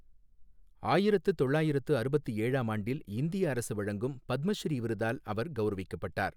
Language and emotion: Tamil, neutral